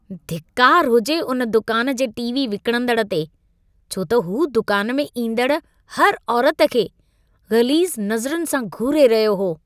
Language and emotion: Sindhi, disgusted